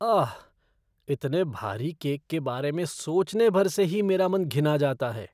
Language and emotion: Hindi, disgusted